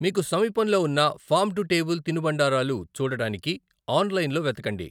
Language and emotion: Telugu, neutral